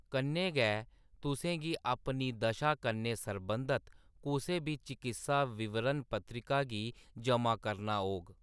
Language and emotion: Dogri, neutral